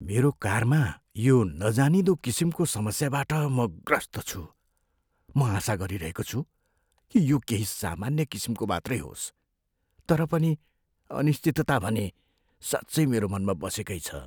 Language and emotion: Nepali, fearful